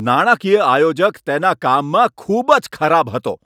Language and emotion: Gujarati, angry